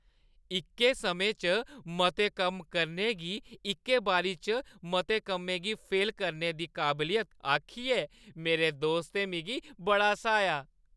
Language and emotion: Dogri, happy